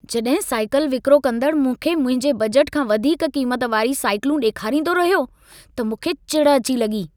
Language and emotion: Sindhi, angry